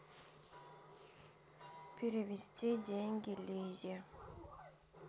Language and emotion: Russian, neutral